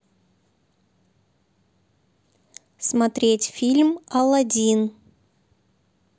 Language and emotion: Russian, neutral